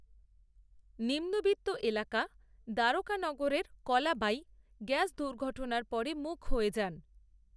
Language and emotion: Bengali, neutral